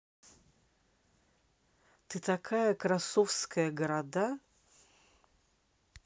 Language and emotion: Russian, positive